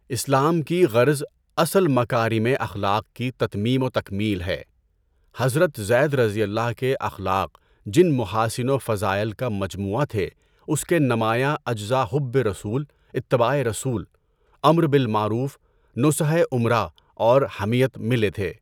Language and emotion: Urdu, neutral